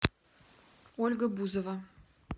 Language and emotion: Russian, neutral